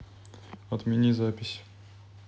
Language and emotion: Russian, neutral